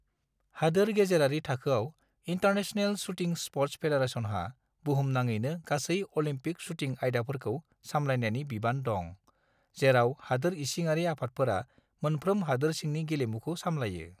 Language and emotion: Bodo, neutral